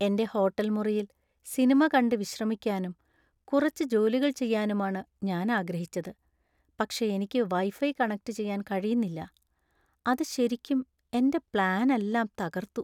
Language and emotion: Malayalam, sad